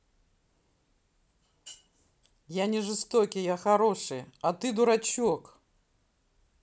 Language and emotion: Russian, neutral